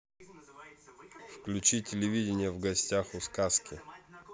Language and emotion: Russian, neutral